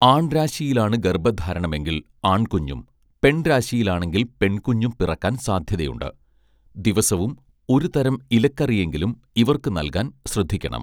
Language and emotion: Malayalam, neutral